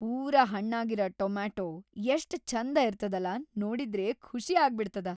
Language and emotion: Kannada, happy